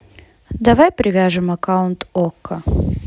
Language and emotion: Russian, neutral